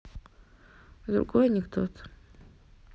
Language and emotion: Russian, neutral